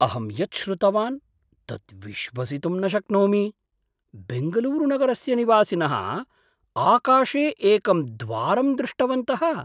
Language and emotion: Sanskrit, surprised